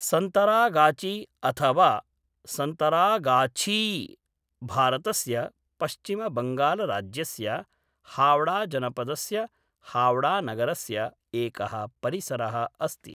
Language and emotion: Sanskrit, neutral